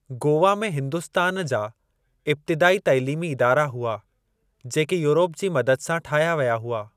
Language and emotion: Sindhi, neutral